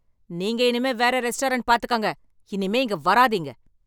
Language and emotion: Tamil, angry